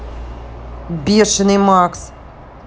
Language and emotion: Russian, angry